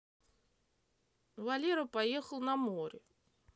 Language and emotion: Russian, neutral